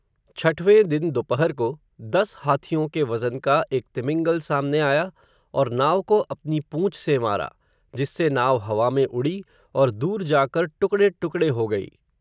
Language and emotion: Hindi, neutral